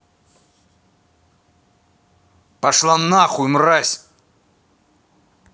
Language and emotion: Russian, angry